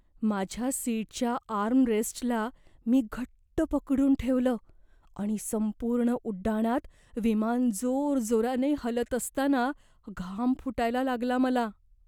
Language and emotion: Marathi, fearful